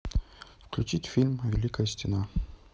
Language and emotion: Russian, neutral